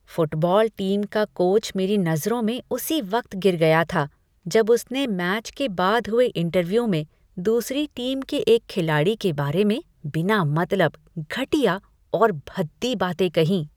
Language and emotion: Hindi, disgusted